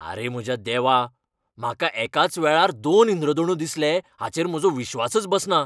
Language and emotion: Goan Konkani, angry